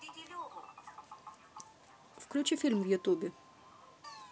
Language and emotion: Russian, neutral